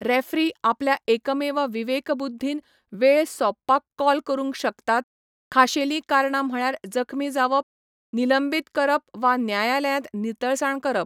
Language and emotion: Goan Konkani, neutral